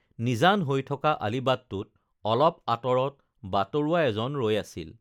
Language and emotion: Assamese, neutral